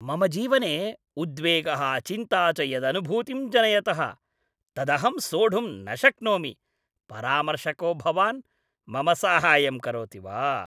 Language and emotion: Sanskrit, disgusted